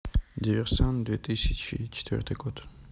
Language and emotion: Russian, neutral